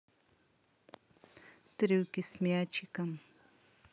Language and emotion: Russian, neutral